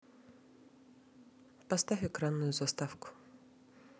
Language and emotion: Russian, neutral